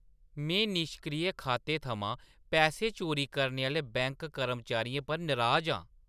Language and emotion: Dogri, disgusted